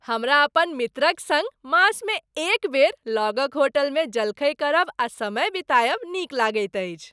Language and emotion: Maithili, happy